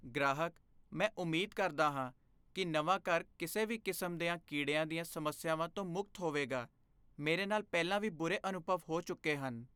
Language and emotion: Punjabi, fearful